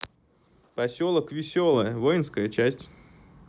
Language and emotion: Russian, neutral